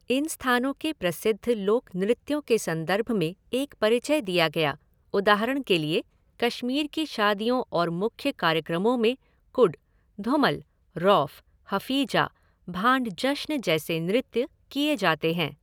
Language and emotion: Hindi, neutral